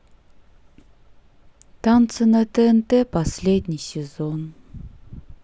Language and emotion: Russian, sad